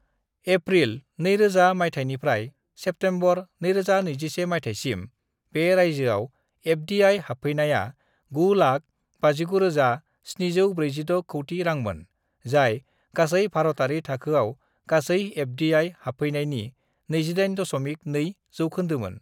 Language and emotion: Bodo, neutral